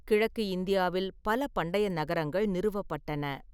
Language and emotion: Tamil, neutral